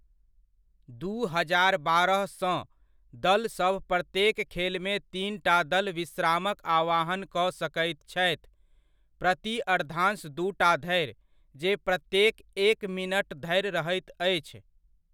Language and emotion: Maithili, neutral